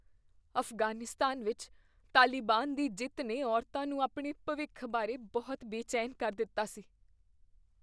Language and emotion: Punjabi, fearful